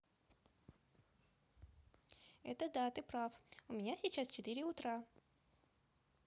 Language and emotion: Russian, positive